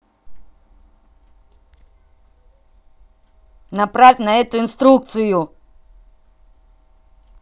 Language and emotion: Russian, angry